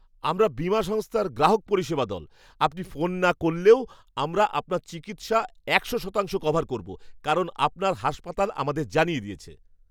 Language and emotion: Bengali, surprised